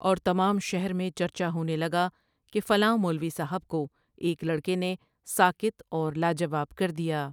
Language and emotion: Urdu, neutral